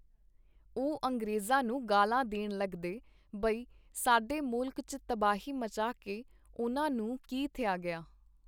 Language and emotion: Punjabi, neutral